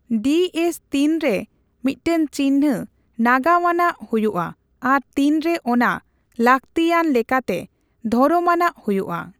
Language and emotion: Santali, neutral